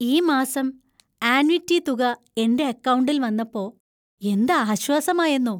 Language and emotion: Malayalam, happy